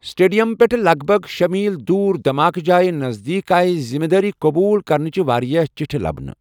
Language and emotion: Kashmiri, neutral